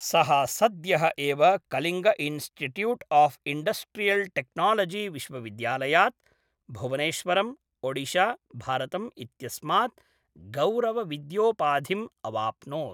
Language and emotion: Sanskrit, neutral